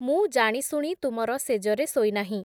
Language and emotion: Odia, neutral